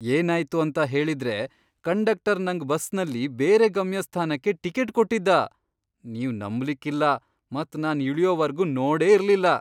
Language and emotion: Kannada, surprised